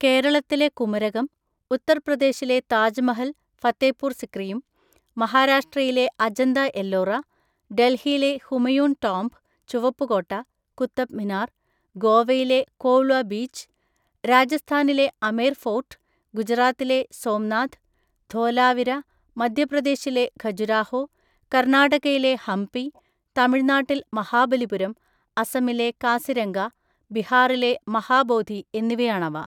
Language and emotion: Malayalam, neutral